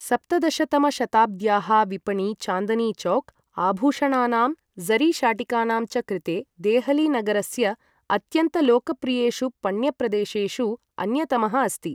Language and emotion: Sanskrit, neutral